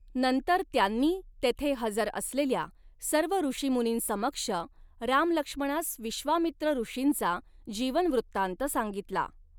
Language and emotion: Marathi, neutral